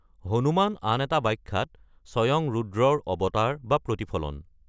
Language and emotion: Assamese, neutral